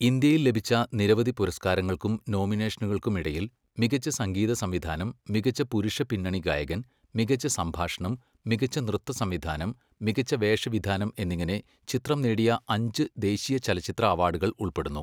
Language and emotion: Malayalam, neutral